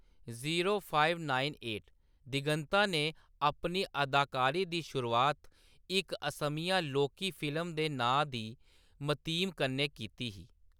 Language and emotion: Dogri, neutral